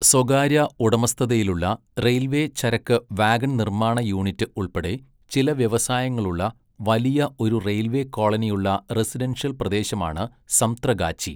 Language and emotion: Malayalam, neutral